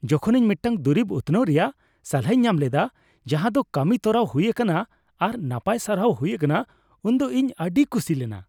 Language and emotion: Santali, happy